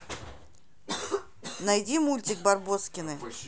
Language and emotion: Russian, neutral